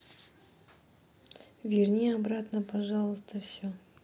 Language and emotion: Russian, sad